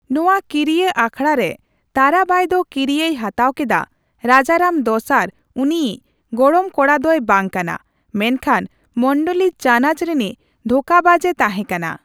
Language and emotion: Santali, neutral